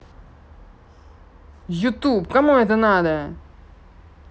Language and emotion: Russian, angry